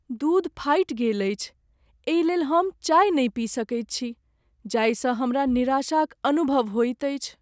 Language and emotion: Maithili, sad